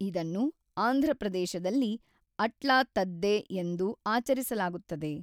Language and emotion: Kannada, neutral